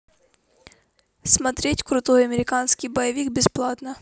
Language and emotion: Russian, neutral